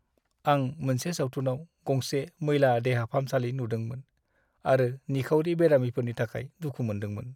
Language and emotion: Bodo, sad